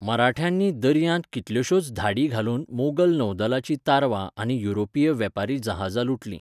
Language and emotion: Goan Konkani, neutral